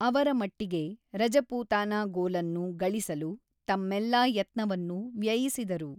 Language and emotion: Kannada, neutral